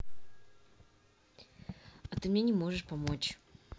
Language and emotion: Russian, neutral